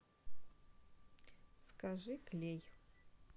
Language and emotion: Russian, neutral